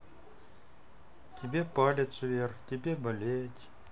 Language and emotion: Russian, sad